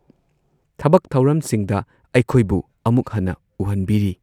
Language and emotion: Manipuri, neutral